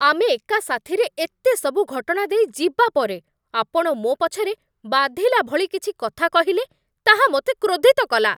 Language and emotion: Odia, angry